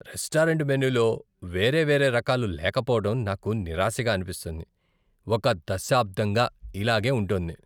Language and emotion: Telugu, disgusted